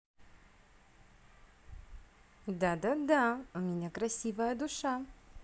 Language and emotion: Russian, positive